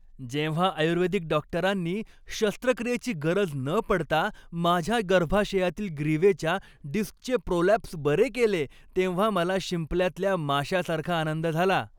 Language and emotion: Marathi, happy